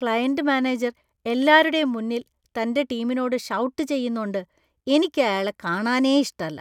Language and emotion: Malayalam, disgusted